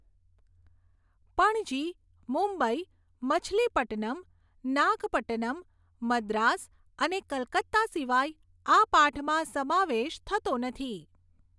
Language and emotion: Gujarati, neutral